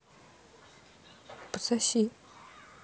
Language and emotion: Russian, neutral